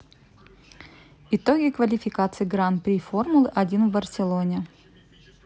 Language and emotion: Russian, neutral